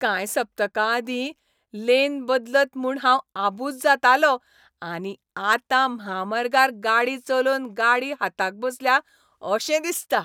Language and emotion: Goan Konkani, happy